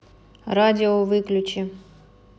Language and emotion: Russian, angry